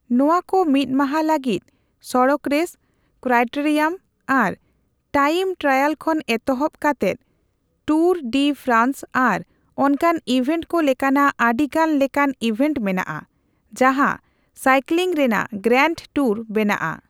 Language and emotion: Santali, neutral